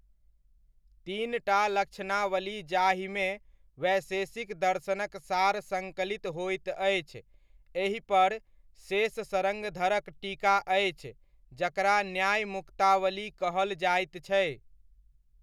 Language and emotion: Maithili, neutral